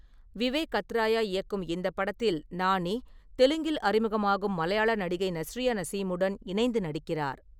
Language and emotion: Tamil, neutral